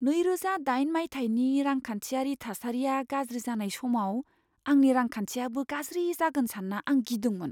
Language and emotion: Bodo, fearful